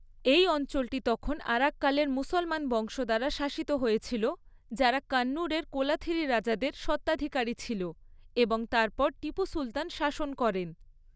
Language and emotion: Bengali, neutral